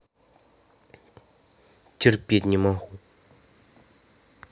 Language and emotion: Russian, angry